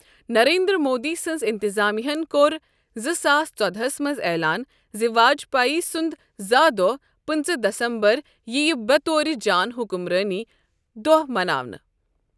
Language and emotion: Kashmiri, neutral